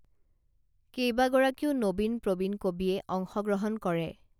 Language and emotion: Assamese, neutral